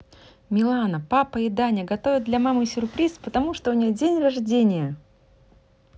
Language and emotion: Russian, positive